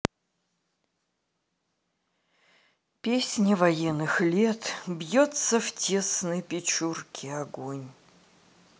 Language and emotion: Russian, sad